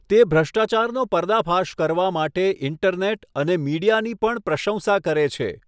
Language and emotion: Gujarati, neutral